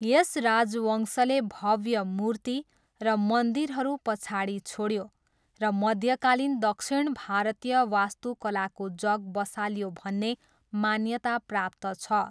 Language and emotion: Nepali, neutral